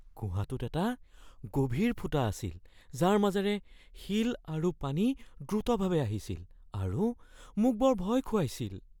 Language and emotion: Assamese, fearful